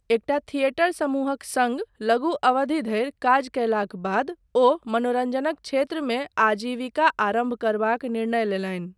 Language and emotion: Maithili, neutral